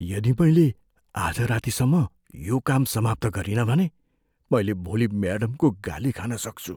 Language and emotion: Nepali, fearful